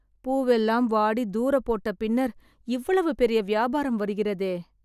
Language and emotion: Tamil, sad